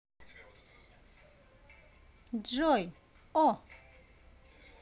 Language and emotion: Russian, positive